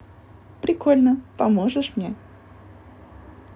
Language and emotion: Russian, positive